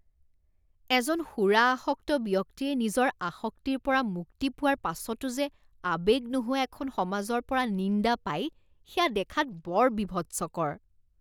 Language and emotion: Assamese, disgusted